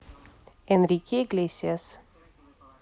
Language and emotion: Russian, neutral